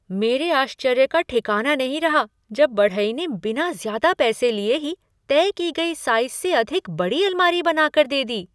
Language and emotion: Hindi, surprised